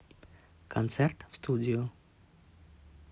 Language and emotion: Russian, neutral